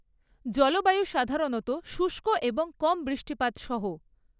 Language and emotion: Bengali, neutral